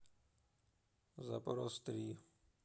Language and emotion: Russian, neutral